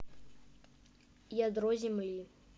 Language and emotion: Russian, neutral